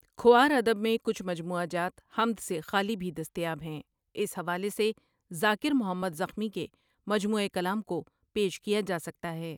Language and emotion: Urdu, neutral